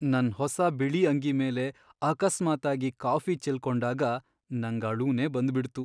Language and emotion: Kannada, sad